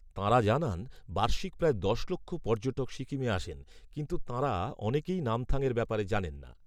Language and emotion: Bengali, neutral